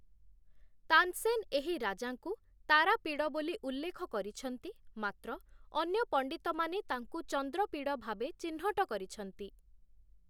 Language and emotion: Odia, neutral